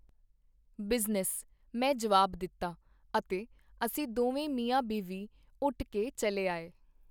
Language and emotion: Punjabi, neutral